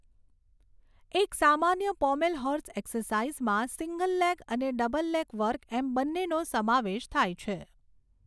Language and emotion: Gujarati, neutral